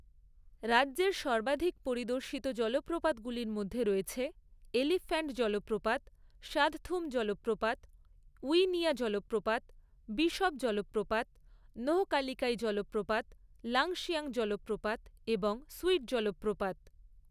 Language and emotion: Bengali, neutral